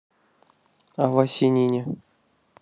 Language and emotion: Russian, neutral